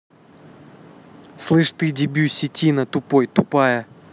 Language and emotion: Russian, angry